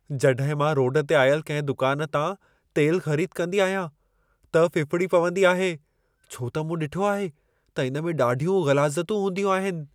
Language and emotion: Sindhi, fearful